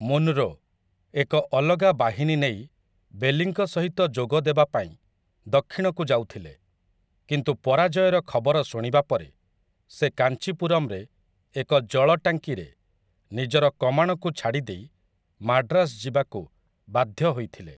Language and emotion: Odia, neutral